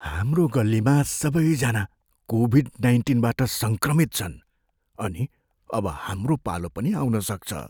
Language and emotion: Nepali, fearful